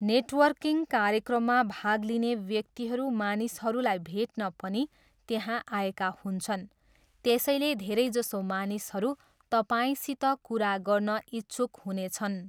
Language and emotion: Nepali, neutral